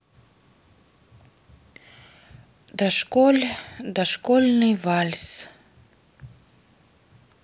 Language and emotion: Russian, sad